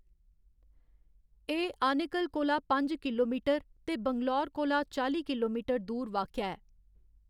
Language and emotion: Dogri, neutral